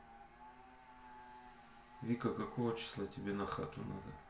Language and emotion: Russian, neutral